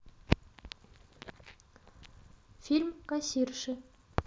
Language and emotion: Russian, neutral